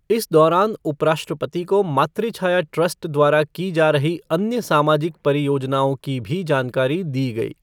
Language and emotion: Hindi, neutral